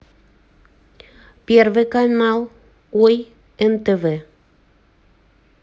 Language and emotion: Russian, neutral